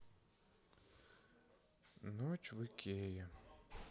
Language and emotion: Russian, sad